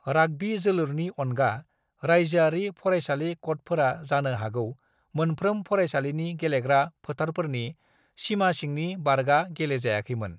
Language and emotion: Bodo, neutral